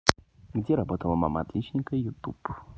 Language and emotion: Russian, neutral